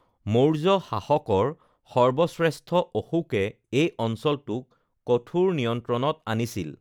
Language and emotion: Assamese, neutral